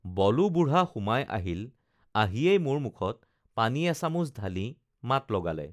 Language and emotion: Assamese, neutral